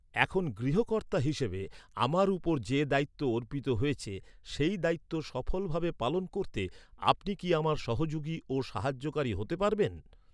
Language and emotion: Bengali, neutral